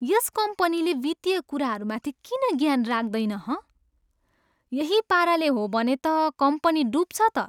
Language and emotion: Nepali, disgusted